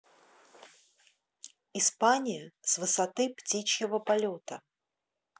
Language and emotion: Russian, neutral